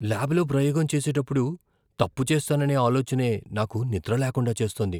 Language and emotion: Telugu, fearful